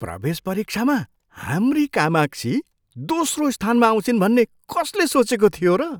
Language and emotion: Nepali, surprised